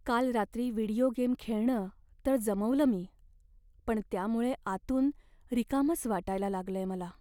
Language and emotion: Marathi, sad